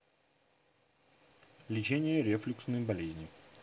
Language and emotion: Russian, neutral